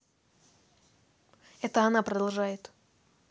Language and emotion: Russian, neutral